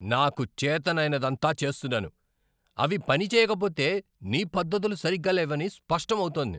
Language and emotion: Telugu, angry